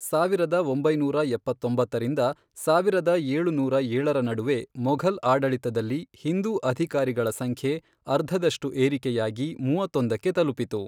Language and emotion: Kannada, neutral